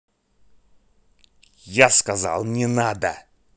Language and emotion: Russian, angry